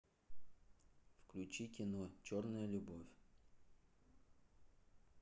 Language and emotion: Russian, neutral